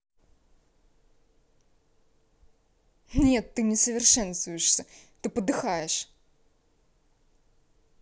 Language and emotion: Russian, angry